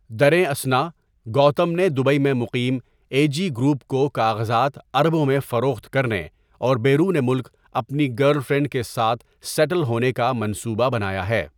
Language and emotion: Urdu, neutral